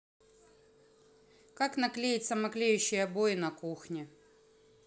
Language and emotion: Russian, neutral